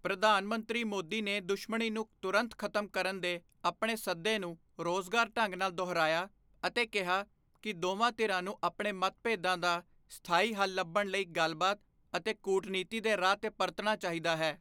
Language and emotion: Punjabi, neutral